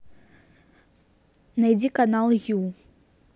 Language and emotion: Russian, neutral